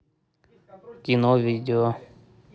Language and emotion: Russian, neutral